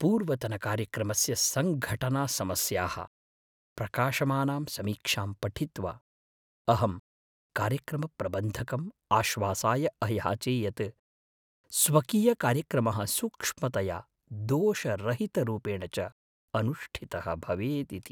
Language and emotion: Sanskrit, fearful